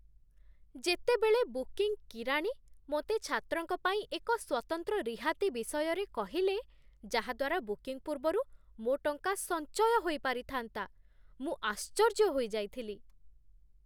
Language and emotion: Odia, surprised